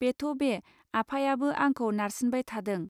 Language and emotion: Bodo, neutral